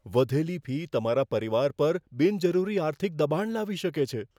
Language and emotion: Gujarati, fearful